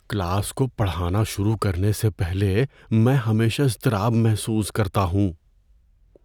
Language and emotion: Urdu, fearful